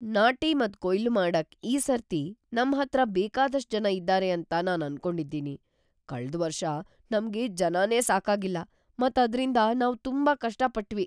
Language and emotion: Kannada, fearful